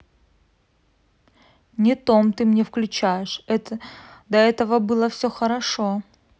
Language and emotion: Russian, neutral